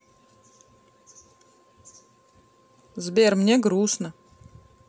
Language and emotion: Russian, sad